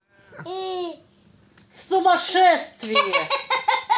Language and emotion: Russian, angry